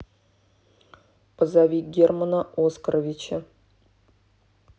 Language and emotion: Russian, neutral